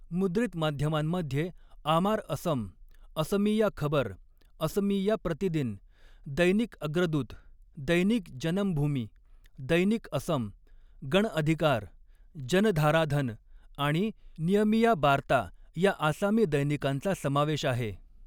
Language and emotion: Marathi, neutral